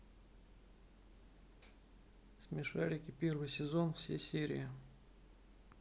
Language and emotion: Russian, neutral